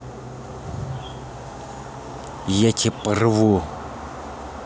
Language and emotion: Russian, angry